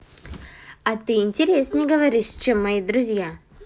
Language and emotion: Russian, positive